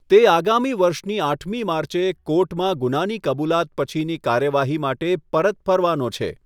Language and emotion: Gujarati, neutral